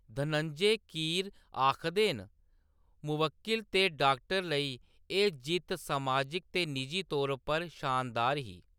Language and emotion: Dogri, neutral